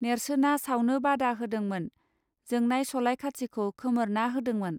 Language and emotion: Bodo, neutral